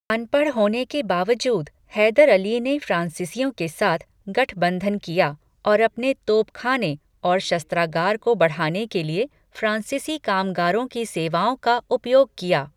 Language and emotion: Hindi, neutral